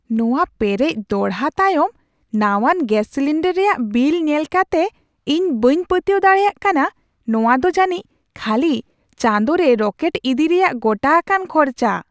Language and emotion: Santali, surprised